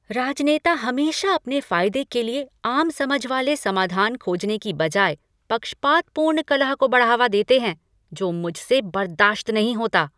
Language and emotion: Hindi, angry